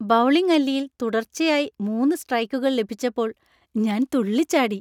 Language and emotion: Malayalam, happy